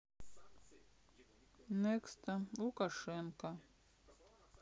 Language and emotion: Russian, sad